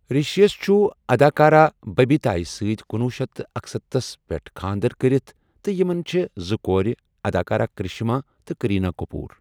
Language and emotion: Kashmiri, neutral